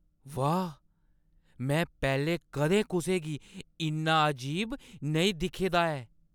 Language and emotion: Dogri, surprised